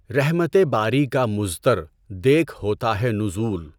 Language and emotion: Urdu, neutral